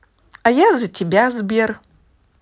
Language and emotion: Russian, positive